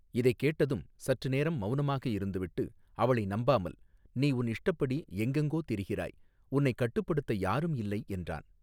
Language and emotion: Tamil, neutral